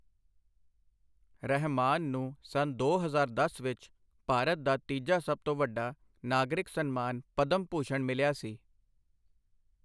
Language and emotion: Punjabi, neutral